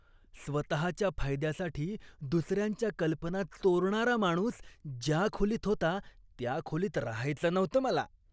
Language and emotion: Marathi, disgusted